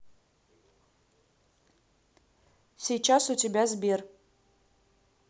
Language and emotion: Russian, neutral